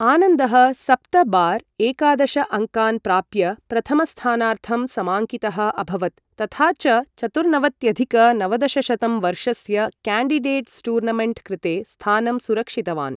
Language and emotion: Sanskrit, neutral